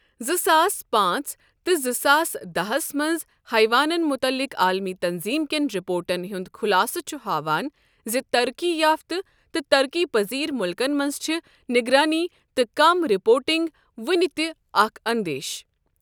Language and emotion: Kashmiri, neutral